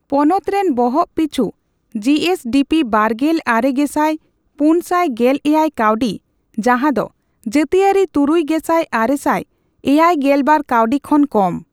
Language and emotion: Santali, neutral